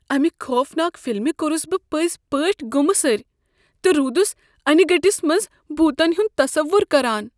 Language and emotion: Kashmiri, fearful